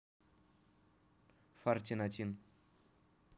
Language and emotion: Russian, neutral